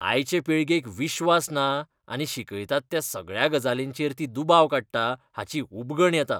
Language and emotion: Goan Konkani, disgusted